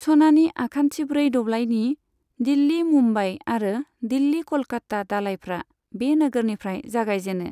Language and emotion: Bodo, neutral